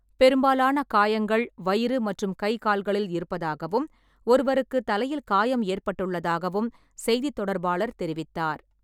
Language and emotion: Tamil, neutral